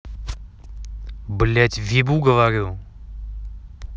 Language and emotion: Russian, angry